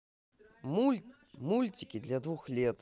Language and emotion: Russian, positive